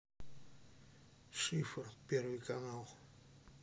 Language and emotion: Russian, neutral